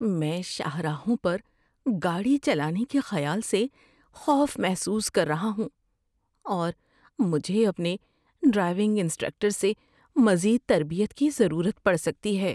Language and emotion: Urdu, fearful